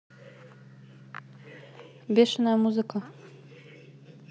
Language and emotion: Russian, neutral